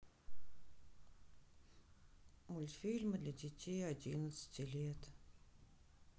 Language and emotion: Russian, sad